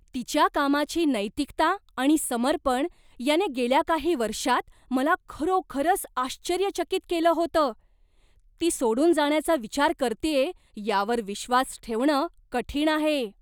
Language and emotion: Marathi, surprised